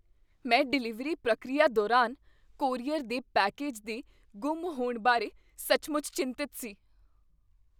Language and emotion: Punjabi, fearful